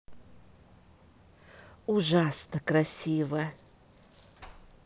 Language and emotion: Russian, positive